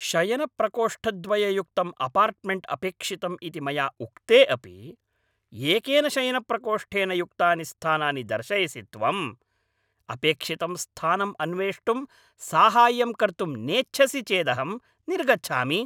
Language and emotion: Sanskrit, angry